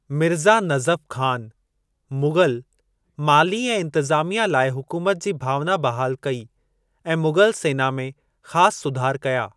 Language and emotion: Sindhi, neutral